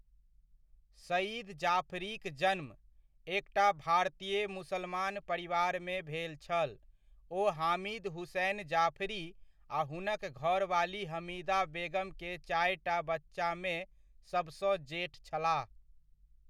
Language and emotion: Maithili, neutral